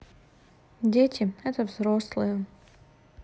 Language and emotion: Russian, sad